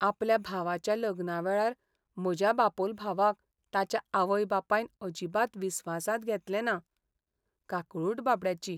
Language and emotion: Goan Konkani, sad